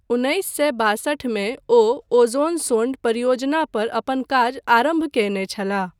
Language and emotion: Maithili, neutral